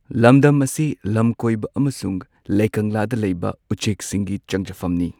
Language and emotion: Manipuri, neutral